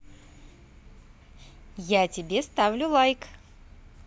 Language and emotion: Russian, positive